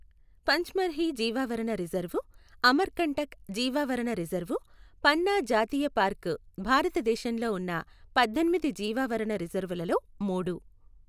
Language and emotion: Telugu, neutral